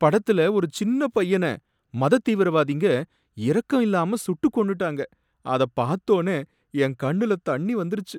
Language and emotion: Tamil, sad